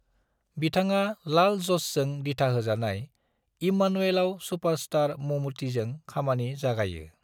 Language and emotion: Bodo, neutral